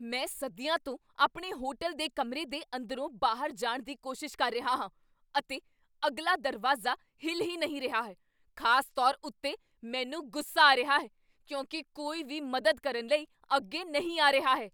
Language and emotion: Punjabi, angry